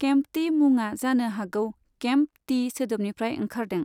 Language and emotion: Bodo, neutral